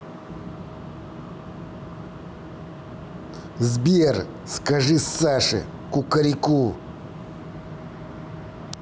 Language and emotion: Russian, angry